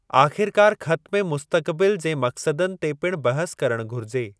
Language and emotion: Sindhi, neutral